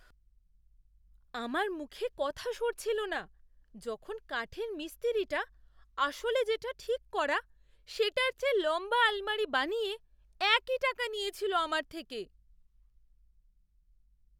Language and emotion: Bengali, surprised